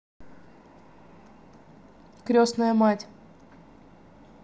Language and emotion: Russian, neutral